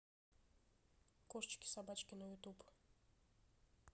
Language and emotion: Russian, neutral